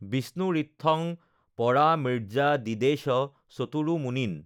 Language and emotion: Assamese, neutral